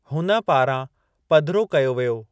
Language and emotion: Sindhi, neutral